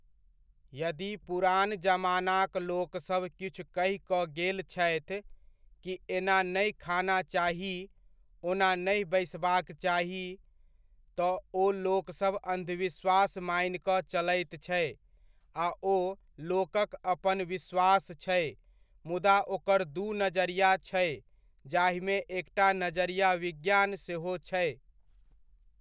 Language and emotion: Maithili, neutral